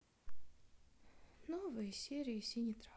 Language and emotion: Russian, sad